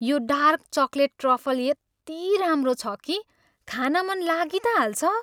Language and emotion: Nepali, happy